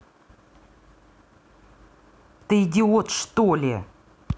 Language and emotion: Russian, angry